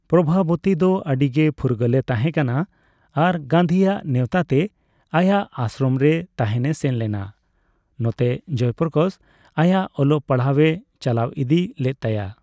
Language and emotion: Santali, neutral